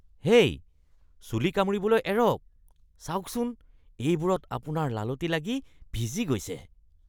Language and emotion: Assamese, disgusted